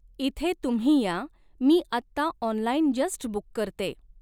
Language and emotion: Marathi, neutral